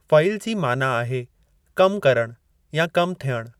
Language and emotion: Sindhi, neutral